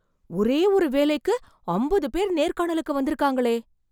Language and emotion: Tamil, surprised